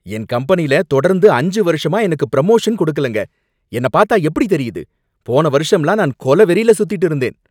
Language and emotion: Tamil, angry